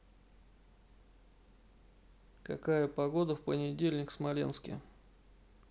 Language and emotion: Russian, neutral